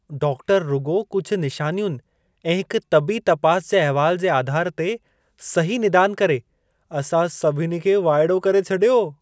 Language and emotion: Sindhi, surprised